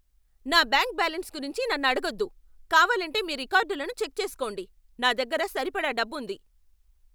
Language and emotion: Telugu, angry